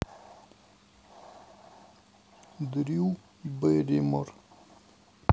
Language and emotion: Russian, neutral